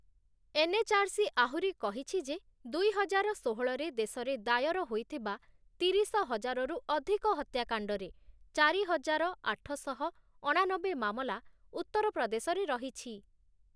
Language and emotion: Odia, neutral